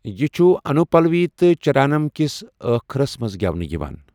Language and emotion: Kashmiri, neutral